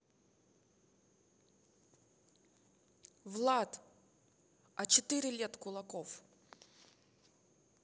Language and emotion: Russian, neutral